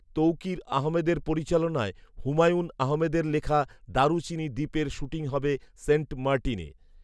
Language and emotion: Bengali, neutral